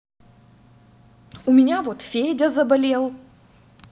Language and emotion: Russian, angry